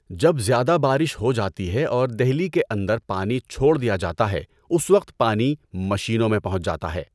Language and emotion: Urdu, neutral